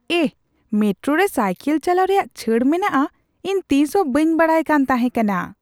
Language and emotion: Santali, surprised